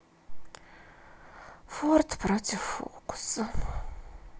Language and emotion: Russian, sad